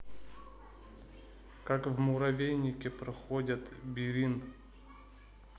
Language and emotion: Russian, neutral